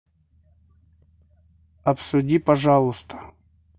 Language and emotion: Russian, neutral